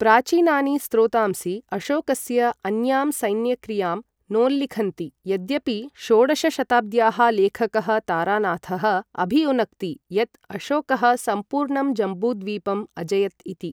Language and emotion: Sanskrit, neutral